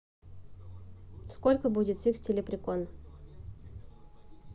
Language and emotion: Russian, neutral